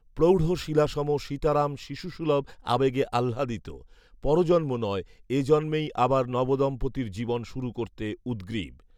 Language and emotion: Bengali, neutral